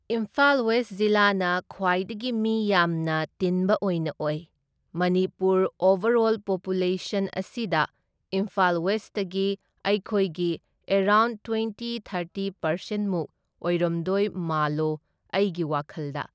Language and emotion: Manipuri, neutral